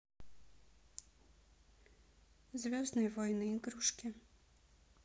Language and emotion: Russian, neutral